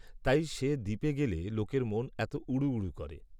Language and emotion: Bengali, neutral